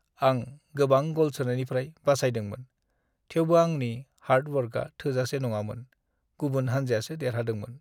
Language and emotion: Bodo, sad